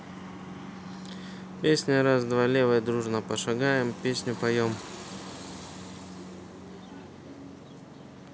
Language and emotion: Russian, neutral